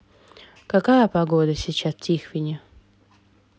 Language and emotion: Russian, neutral